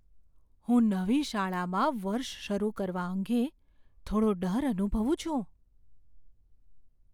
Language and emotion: Gujarati, fearful